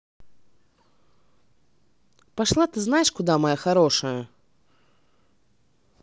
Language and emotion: Russian, angry